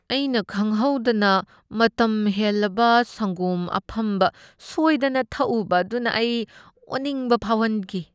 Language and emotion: Manipuri, disgusted